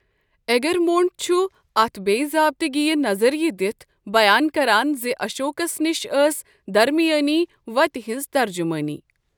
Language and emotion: Kashmiri, neutral